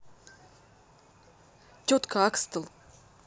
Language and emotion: Russian, neutral